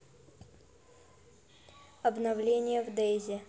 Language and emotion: Russian, neutral